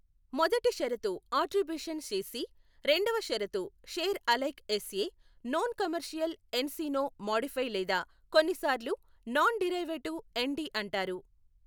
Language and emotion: Telugu, neutral